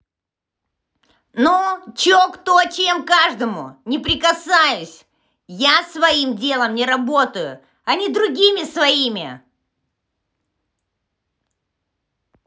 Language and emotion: Russian, angry